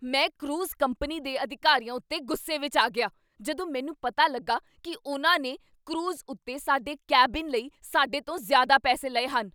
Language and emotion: Punjabi, angry